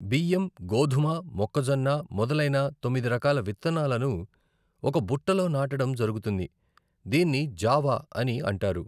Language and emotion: Telugu, neutral